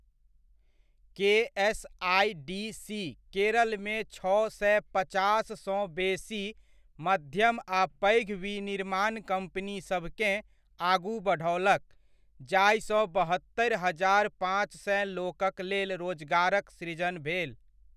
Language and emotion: Maithili, neutral